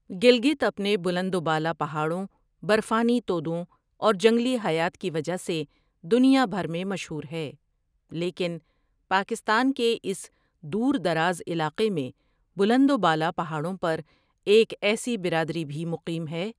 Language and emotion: Urdu, neutral